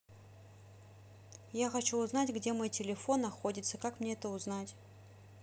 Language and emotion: Russian, neutral